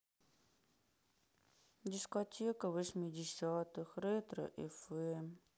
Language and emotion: Russian, sad